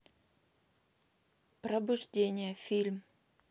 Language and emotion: Russian, neutral